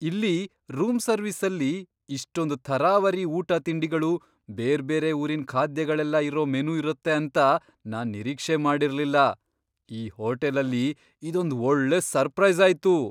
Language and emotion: Kannada, surprised